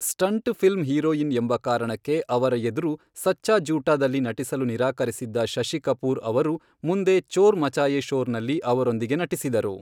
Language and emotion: Kannada, neutral